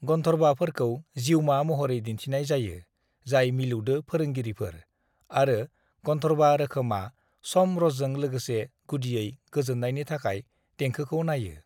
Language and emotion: Bodo, neutral